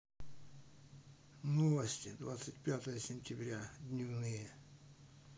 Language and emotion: Russian, neutral